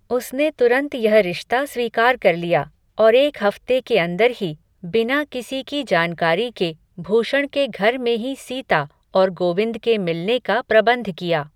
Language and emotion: Hindi, neutral